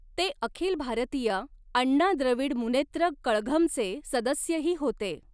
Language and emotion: Marathi, neutral